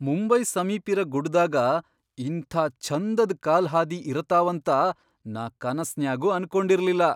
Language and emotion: Kannada, surprised